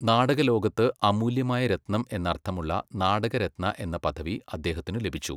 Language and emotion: Malayalam, neutral